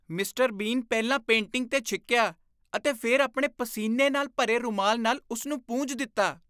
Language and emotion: Punjabi, disgusted